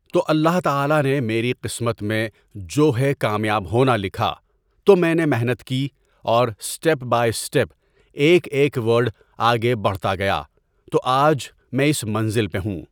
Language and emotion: Urdu, neutral